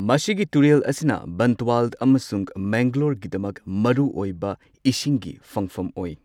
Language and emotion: Manipuri, neutral